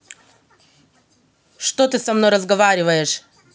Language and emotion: Russian, angry